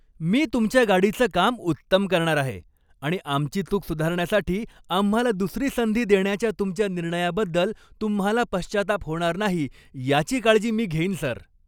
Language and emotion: Marathi, happy